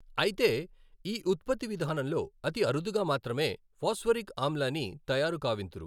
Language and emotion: Telugu, neutral